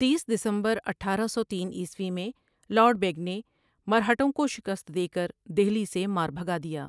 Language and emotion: Urdu, neutral